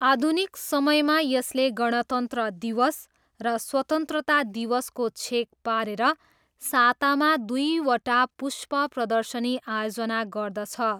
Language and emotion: Nepali, neutral